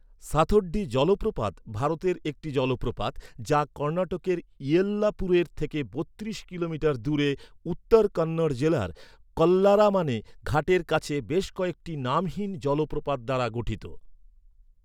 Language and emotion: Bengali, neutral